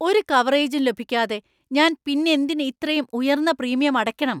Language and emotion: Malayalam, angry